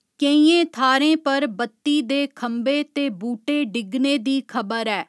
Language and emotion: Dogri, neutral